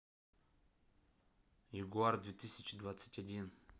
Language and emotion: Russian, neutral